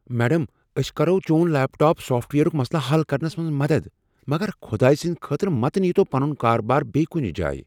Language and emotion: Kashmiri, fearful